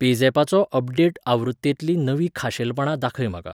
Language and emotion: Goan Konkani, neutral